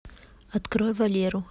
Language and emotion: Russian, neutral